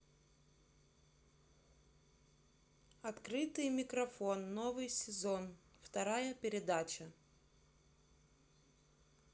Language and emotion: Russian, neutral